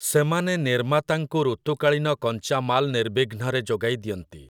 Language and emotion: Odia, neutral